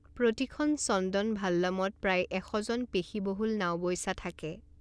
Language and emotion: Assamese, neutral